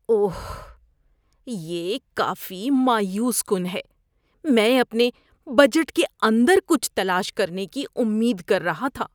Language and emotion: Urdu, disgusted